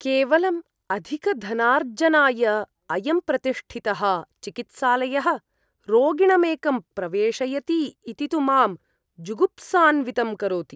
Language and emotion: Sanskrit, disgusted